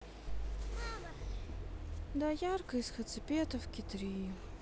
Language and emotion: Russian, sad